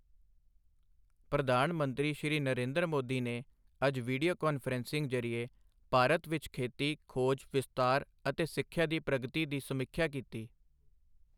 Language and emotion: Punjabi, neutral